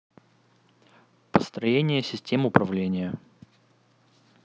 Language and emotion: Russian, neutral